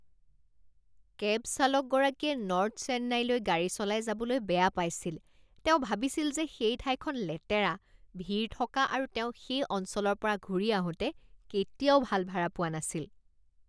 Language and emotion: Assamese, disgusted